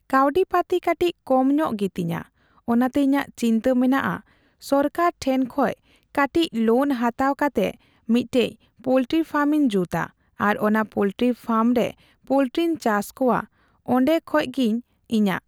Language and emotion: Santali, neutral